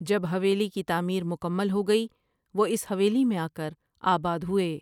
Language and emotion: Urdu, neutral